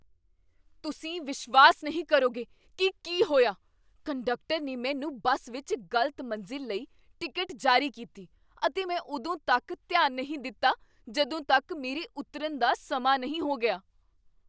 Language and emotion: Punjabi, surprised